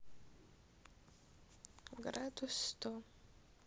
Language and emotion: Russian, sad